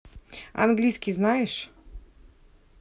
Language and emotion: Russian, neutral